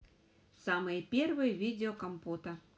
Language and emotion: Russian, positive